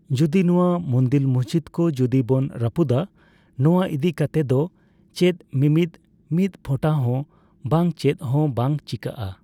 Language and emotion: Santali, neutral